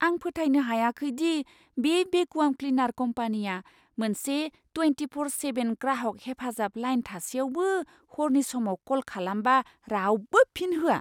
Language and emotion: Bodo, surprised